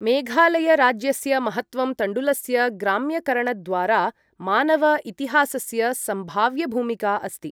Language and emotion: Sanskrit, neutral